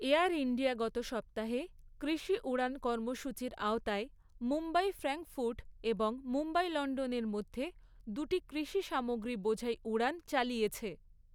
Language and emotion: Bengali, neutral